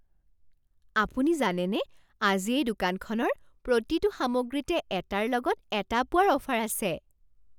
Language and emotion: Assamese, surprised